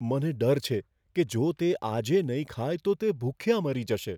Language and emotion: Gujarati, fearful